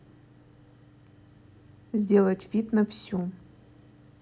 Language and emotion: Russian, neutral